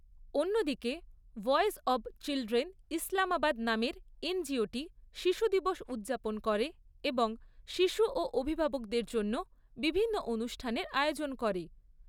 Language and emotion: Bengali, neutral